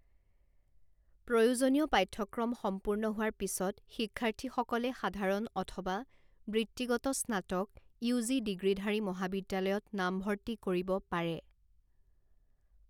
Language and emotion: Assamese, neutral